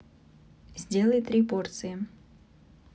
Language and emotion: Russian, neutral